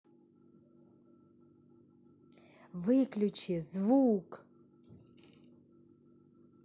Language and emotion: Russian, angry